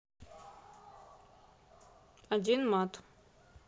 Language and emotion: Russian, neutral